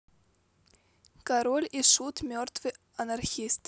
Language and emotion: Russian, neutral